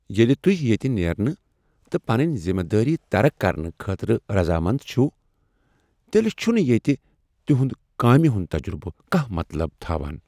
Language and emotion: Kashmiri, angry